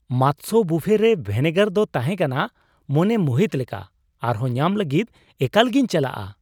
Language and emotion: Santali, surprised